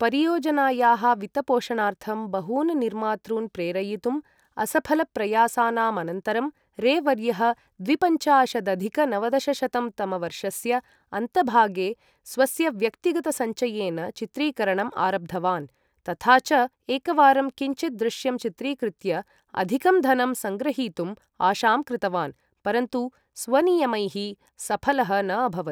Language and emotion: Sanskrit, neutral